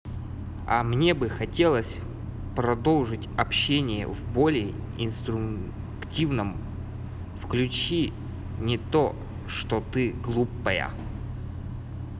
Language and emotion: Russian, positive